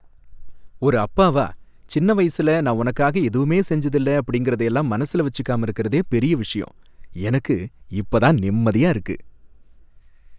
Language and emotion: Tamil, happy